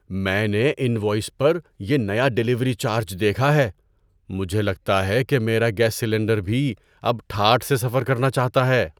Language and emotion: Urdu, surprised